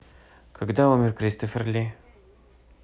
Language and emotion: Russian, neutral